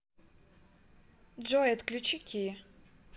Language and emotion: Russian, neutral